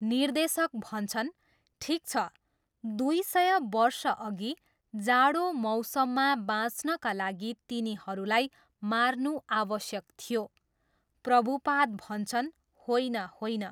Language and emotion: Nepali, neutral